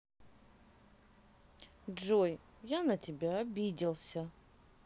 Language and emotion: Russian, sad